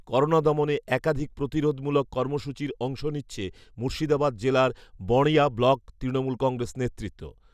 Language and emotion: Bengali, neutral